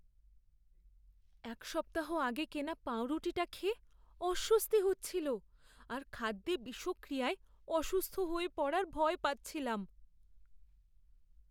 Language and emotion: Bengali, fearful